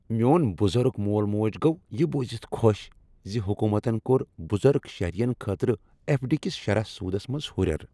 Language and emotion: Kashmiri, happy